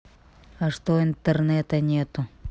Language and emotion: Russian, neutral